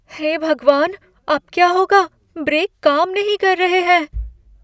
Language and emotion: Hindi, fearful